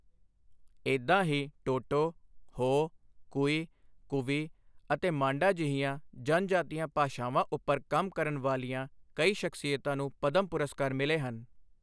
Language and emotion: Punjabi, neutral